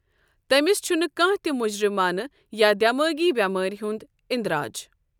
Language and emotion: Kashmiri, neutral